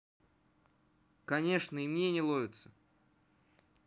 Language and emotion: Russian, neutral